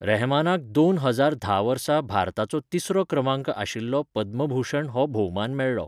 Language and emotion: Goan Konkani, neutral